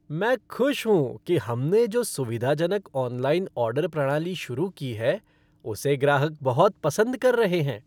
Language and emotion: Hindi, happy